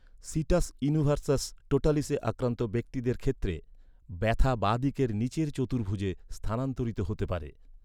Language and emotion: Bengali, neutral